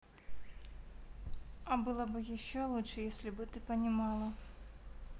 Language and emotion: Russian, neutral